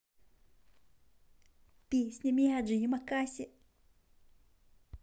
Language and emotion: Russian, positive